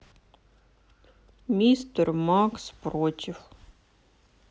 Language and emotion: Russian, sad